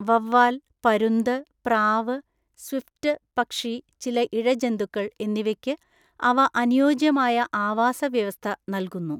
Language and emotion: Malayalam, neutral